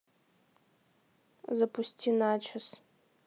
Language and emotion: Russian, neutral